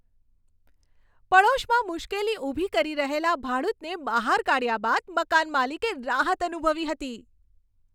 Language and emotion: Gujarati, happy